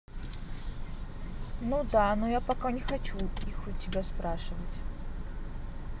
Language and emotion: Russian, neutral